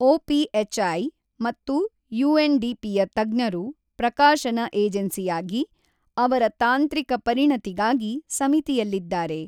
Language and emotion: Kannada, neutral